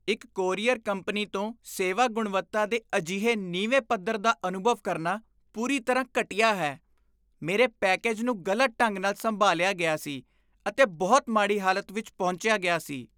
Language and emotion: Punjabi, disgusted